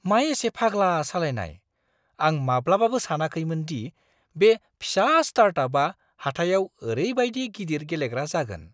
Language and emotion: Bodo, surprised